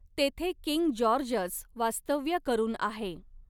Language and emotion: Marathi, neutral